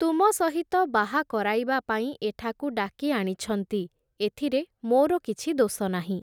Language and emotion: Odia, neutral